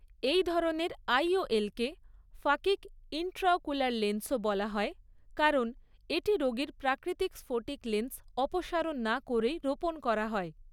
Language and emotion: Bengali, neutral